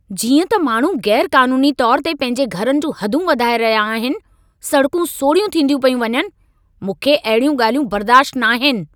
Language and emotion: Sindhi, angry